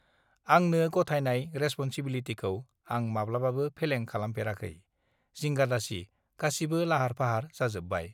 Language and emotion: Bodo, neutral